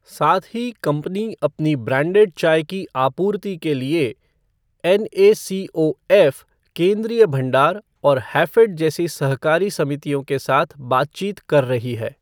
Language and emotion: Hindi, neutral